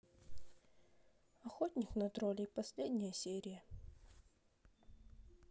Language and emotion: Russian, sad